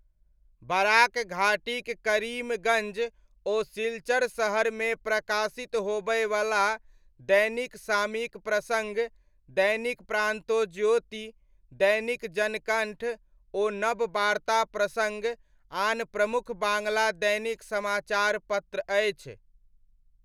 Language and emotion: Maithili, neutral